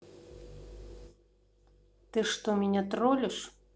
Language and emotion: Russian, neutral